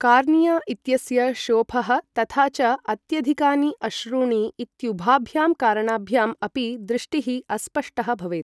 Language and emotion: Sanskrit, neutral